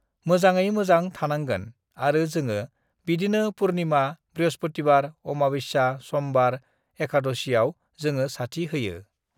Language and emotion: Bodo, neutral